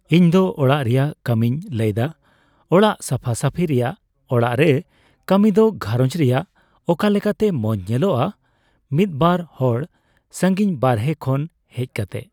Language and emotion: Santali, neutral